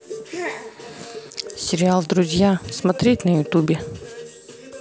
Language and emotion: Russian, neutral